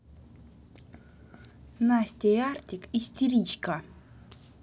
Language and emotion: Russian, angry